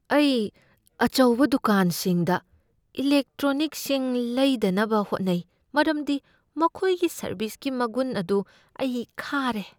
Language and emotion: Manipuri, fearful